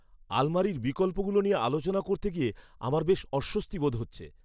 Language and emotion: Bengali, fearful